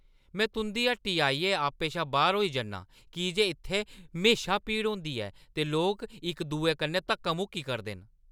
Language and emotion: Dogri, angry